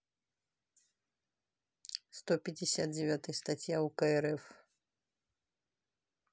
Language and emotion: Russian, neutral